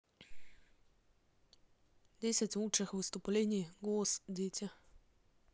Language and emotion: Russian, neutral